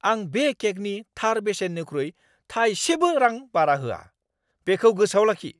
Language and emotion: Bodo, angry